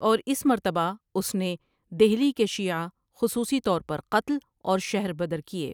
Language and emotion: Urdu, neutral